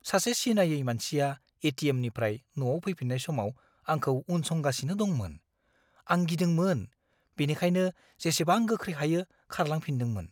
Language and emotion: Bodo, fearful